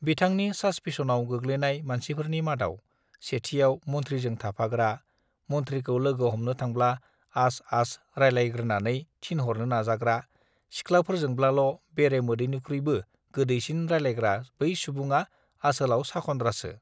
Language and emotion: Bodo, neutral